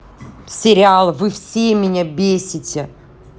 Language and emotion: Russian, angry